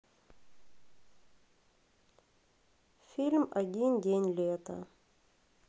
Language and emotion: Russian, sad